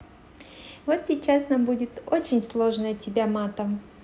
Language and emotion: Russian, positive